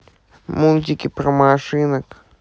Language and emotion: Russian, sad